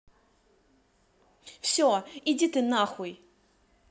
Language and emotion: Russian, angry